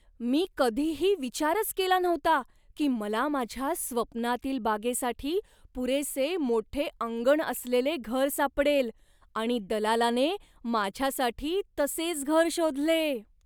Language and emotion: Marathi, surprised